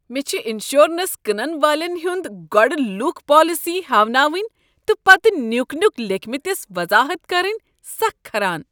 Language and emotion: Kashmiri, disgusted